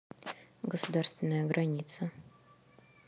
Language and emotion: Russian, neutral